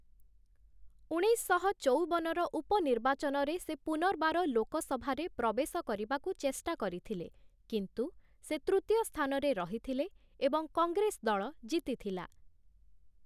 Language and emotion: Odia, neutral